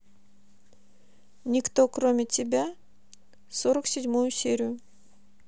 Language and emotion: Russian, neutral